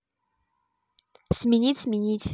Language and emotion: Russian, neutral